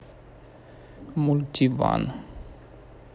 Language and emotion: Russian, neutral